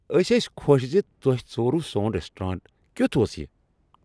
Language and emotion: Kashmiri, happy